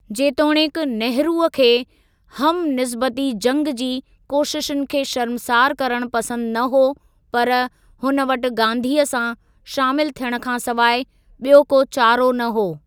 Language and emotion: Sindhi, neutral